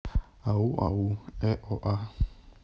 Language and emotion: Russian, neutral